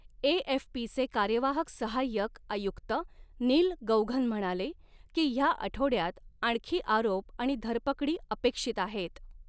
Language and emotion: Marathi, neutral